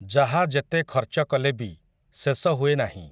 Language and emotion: Odia, neutral